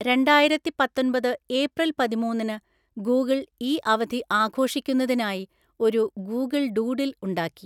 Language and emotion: Malayalam, neutral